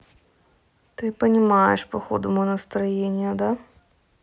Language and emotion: Russian, neutral